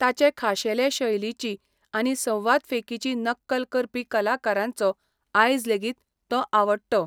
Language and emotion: Goan Konkani, neutral